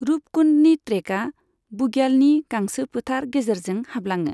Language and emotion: Bodo, neutral